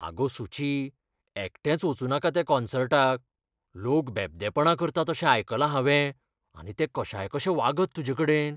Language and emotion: Goan Konkani, fearful